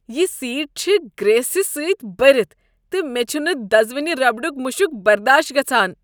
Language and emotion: Kashmiri, disgusted